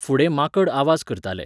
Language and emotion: Goan Konkani, neutral